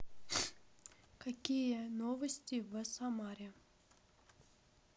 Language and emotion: Russian, neutral